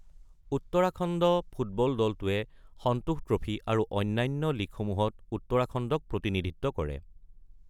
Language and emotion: Assamese, neutral